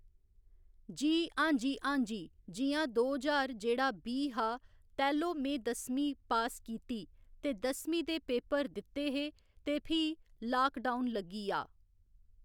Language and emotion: Dogri, neutral